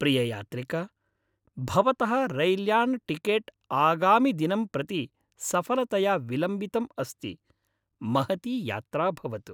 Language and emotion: Sanskrit, happy